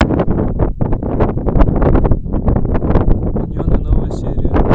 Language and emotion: Russian, neutral